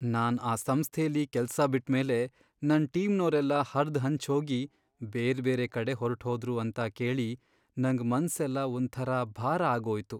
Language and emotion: Kannada, sad